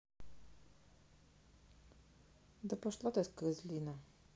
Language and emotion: Russian, neutral